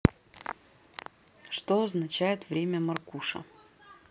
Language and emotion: Russian, neutral